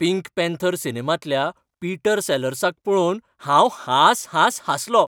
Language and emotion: Goan Konkani, happy